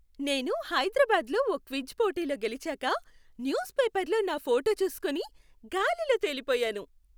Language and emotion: Telugu, happy